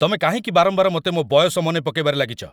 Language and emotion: Odia, angry